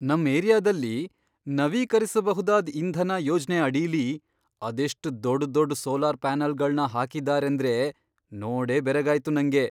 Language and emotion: Kannada, surprised